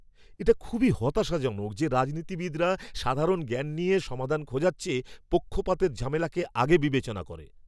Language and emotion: Bengali, angry